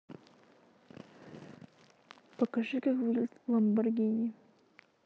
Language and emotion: Russian, neutral